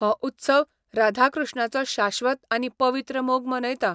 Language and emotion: Goan Konkani, neutral